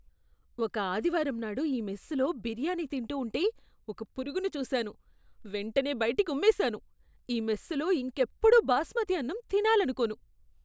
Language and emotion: Telugu, disgusted